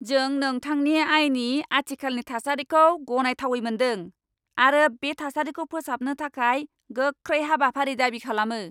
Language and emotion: Bodo, angry